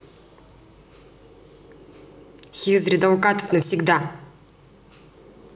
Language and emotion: Russian, angry